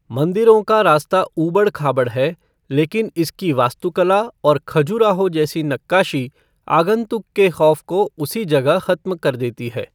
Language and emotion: Hindi, neutral